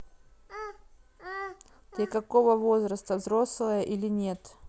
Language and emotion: Russian, neutral